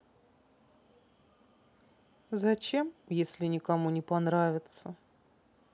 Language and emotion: Russian, sad